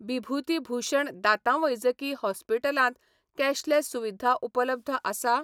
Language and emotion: Goan Konkani, neutral